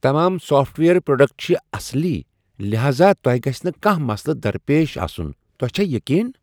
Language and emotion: Kashmiri, surprised